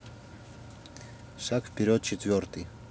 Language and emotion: Russian, neutral